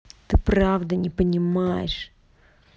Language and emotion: Russian, angry